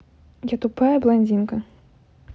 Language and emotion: Russian, neutral